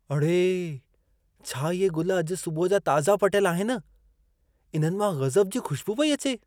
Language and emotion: Sindhi, surprised